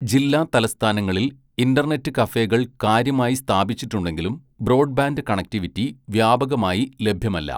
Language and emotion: Malayalam, neutral